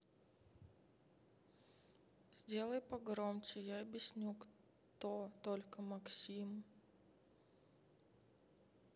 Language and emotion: Russian, sad